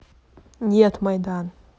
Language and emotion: Russian, neutral